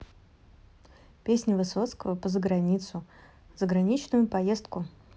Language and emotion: Russian, neutral